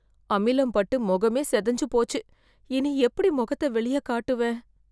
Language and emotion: Tamil, fearful